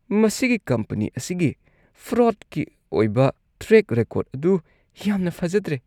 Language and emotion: Manipuri, disgusted